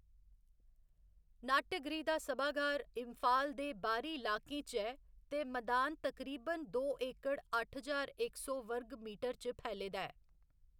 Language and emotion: Dogri, neutral